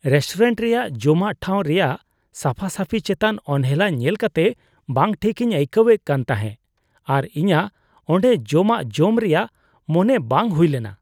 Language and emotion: Santali, disgusted